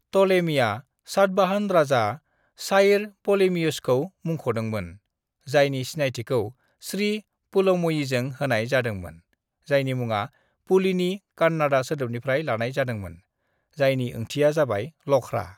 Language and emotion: Bodo, neutral